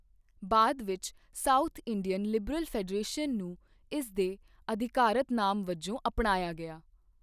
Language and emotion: Punjabi, neutral